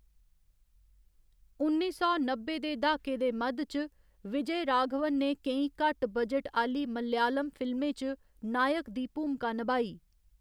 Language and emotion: Dogri, neutral